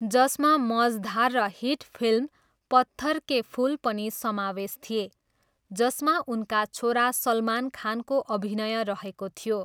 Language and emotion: Nepali, neutral